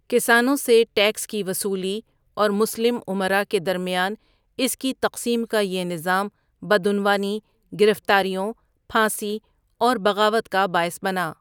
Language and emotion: Urdu, neutral